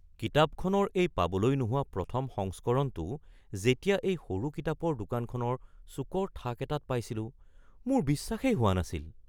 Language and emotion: Assamese, surprised